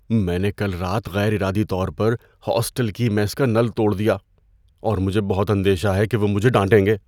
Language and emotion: Urdu, fearful